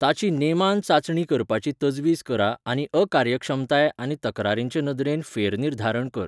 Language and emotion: Goan Konkani, neutral